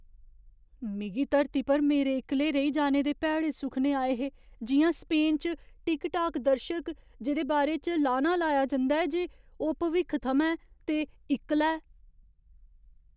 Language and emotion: Dogri, fearful